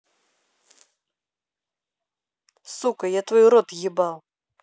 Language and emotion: Russian, angry